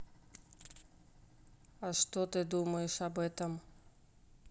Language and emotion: Russian, neutral